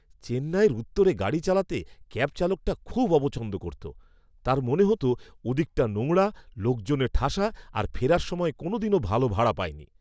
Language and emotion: Bengali, disgusted